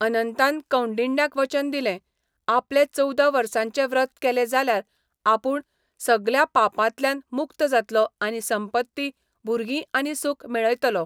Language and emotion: Goan Konkani, neutral